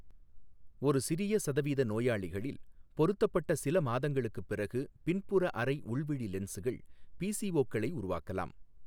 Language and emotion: Tamil, neutral